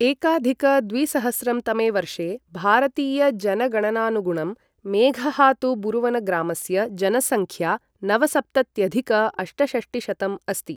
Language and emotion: Sanskrit, neutral